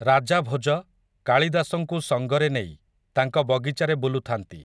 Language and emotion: Odia, neutral